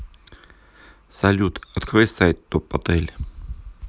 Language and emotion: Russian, neutral